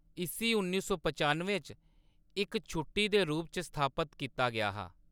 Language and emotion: Dogri, neutral